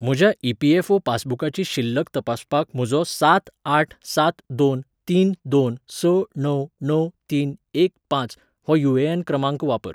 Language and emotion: Goan Konkani, neutral